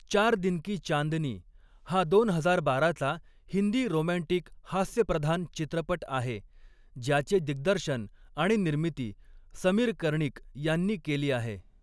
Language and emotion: Marathi, neutral